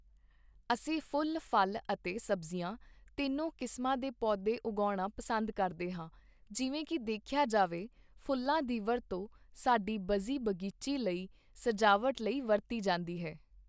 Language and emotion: Punjabi, neutral